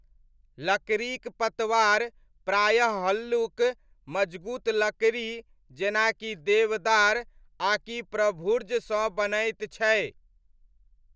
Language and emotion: Maithili, neutral